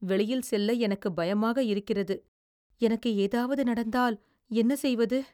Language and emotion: Tamil, fearful